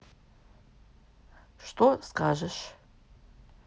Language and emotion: Russian, neutral